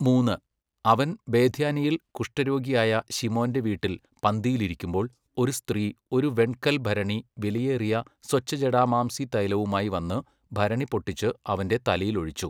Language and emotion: Malayalam, neutral